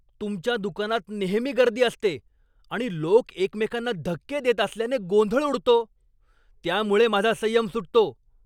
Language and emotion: Marathi, angry